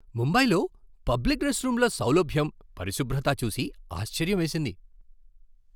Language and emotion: Telugu, surprised